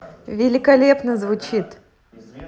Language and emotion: Russian, positive